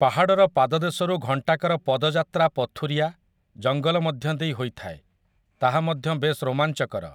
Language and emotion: Odia, neutral